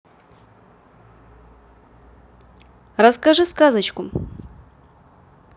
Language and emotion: Russian, positive